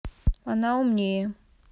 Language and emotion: Russian, neutral